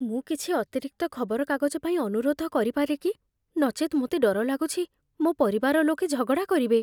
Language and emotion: Odia, fearful